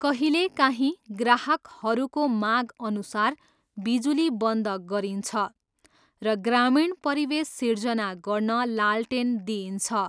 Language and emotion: Nepali, neutral